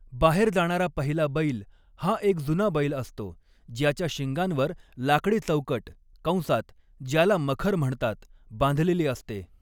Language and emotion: Marathi, neutral